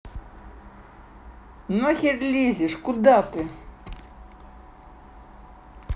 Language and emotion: Russian, angry